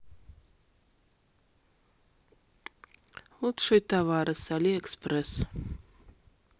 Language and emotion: Russian, neutral